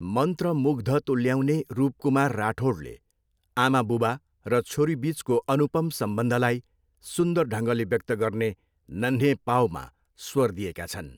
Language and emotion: Nepali, neutral